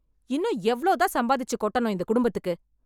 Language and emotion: Tamil, angry